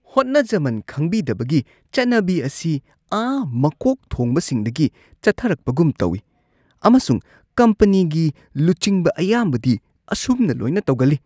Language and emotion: Manipuri, disgusted